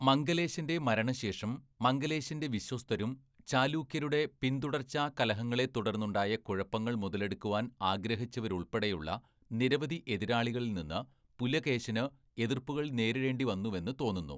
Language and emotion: Malayalam, neutral